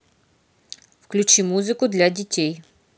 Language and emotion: Russian, neutral